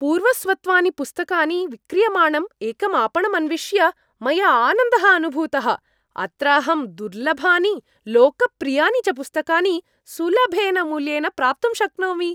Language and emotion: Sanskrit, happy